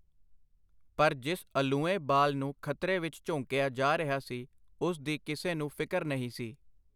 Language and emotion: Punjabi, neutral